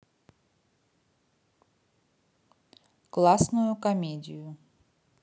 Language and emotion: Russian, neutral